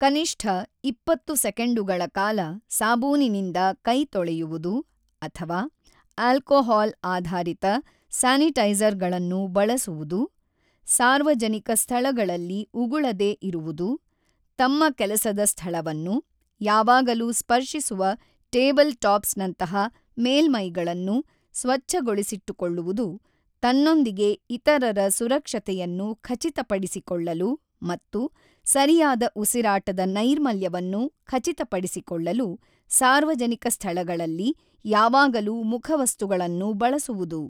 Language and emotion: Kannada, neutral